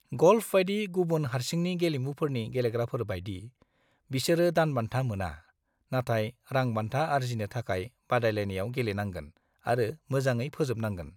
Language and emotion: Bodo, neutral